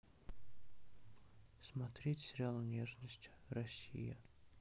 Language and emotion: Russian, sad